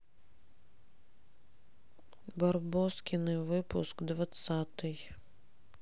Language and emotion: Russian, neutral